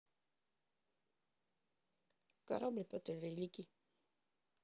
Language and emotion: Russian, neutral